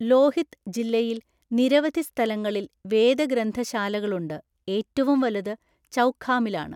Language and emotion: Malayalam, neutral